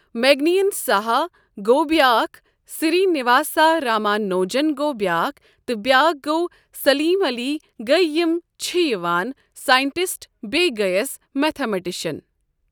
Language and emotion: Kashmiri, neutral